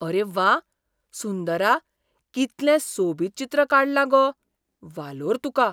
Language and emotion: Goan Konkani, surprised